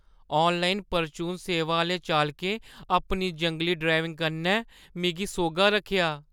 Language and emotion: Dogri, fearful